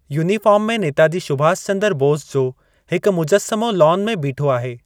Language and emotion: Sindhi, neutral